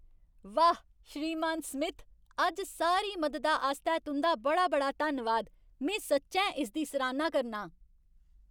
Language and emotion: Dogri, happy